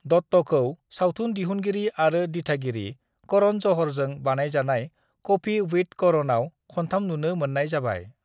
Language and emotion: Bodo, neutral